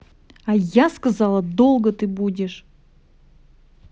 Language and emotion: Russian, angry